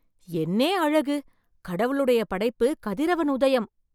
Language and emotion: Tamil, surprised